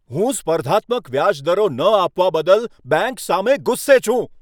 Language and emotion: Gujarati, angry